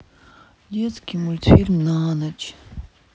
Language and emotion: Russian, sad